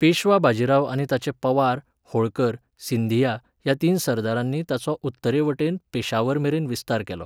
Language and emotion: Goan Konkani, neutral